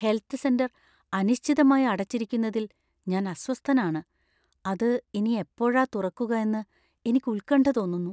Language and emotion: Malayalam, fearful